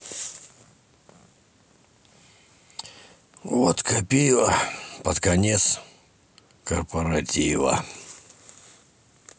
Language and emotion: Russian, sad